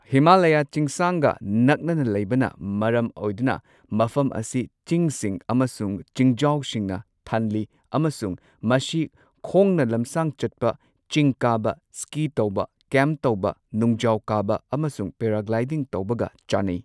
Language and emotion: Manipuri, neutral